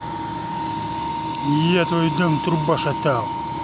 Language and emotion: Russian, angry